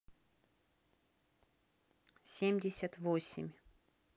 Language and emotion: Russian, neutral